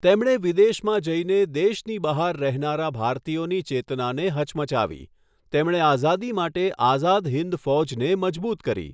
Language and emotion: Gujarati, neutral